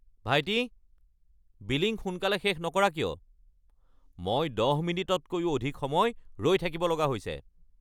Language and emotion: Assamese, angry